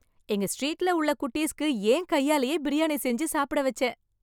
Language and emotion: Tamil, happy